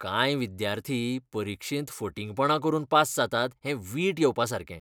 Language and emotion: Goan Konkani, disgusted